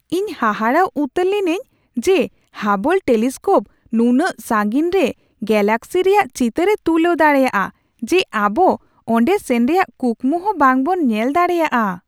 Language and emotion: Santali, surprised